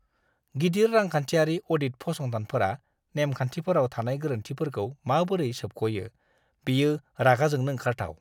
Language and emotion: Bodo, disgusted